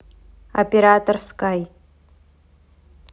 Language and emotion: Russian, neutral